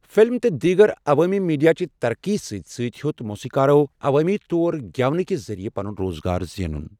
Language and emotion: Kashmiri, neutral